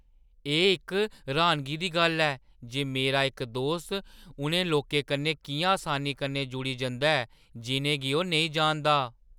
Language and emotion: Dogri, surprised